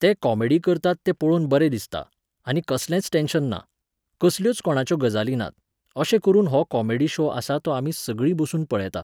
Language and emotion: Goan Konkani, neutral